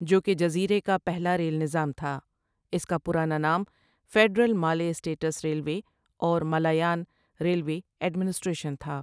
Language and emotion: Urdu, neutral